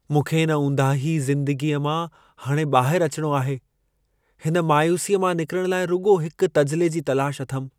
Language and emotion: Sindhi, sad